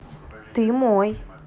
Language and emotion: Russian, neutral